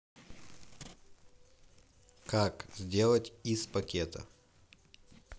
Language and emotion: Russian, neutral